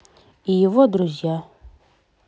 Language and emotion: Russian, neutral